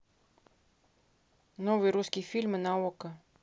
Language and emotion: Russian, neutral